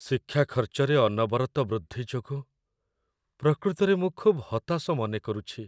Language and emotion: Odia, sad